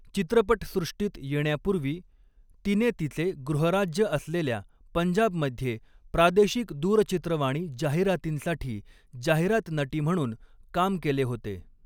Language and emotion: Marathi, neutral